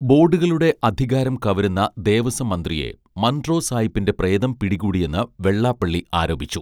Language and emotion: Malayalam, neutral